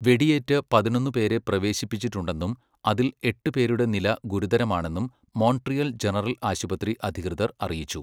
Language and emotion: Malayalam, neutral